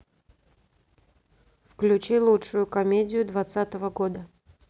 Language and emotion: Russian, neutral